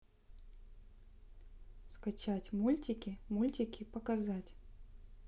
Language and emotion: Russian, neutral